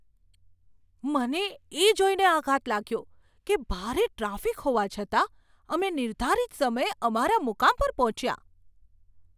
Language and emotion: Gujarati, surprised